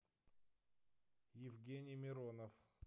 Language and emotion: Russian, neutral